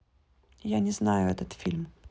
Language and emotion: Russian, neutral